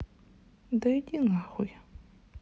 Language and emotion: Russian, angry